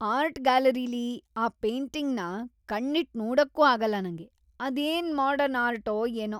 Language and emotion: Kannada, disgusted